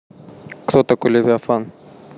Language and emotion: Russian, neutral